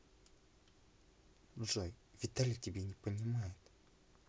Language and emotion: Russian, neutral